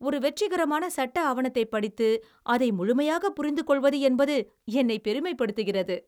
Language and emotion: Tamil, happy